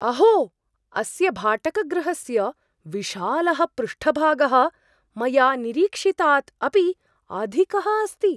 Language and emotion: Sanskrit, surprised